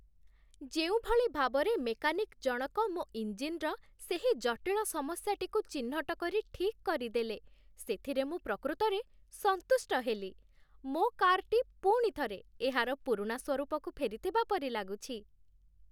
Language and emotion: Odia, happy